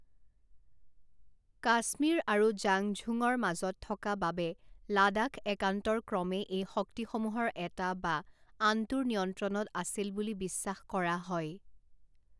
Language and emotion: Assamese, neutral